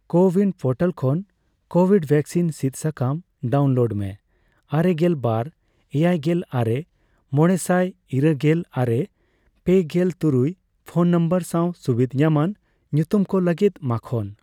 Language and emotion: Santali, neutral